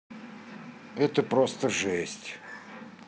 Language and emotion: Russian, neutral